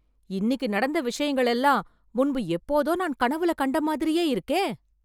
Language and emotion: Tamil, surprised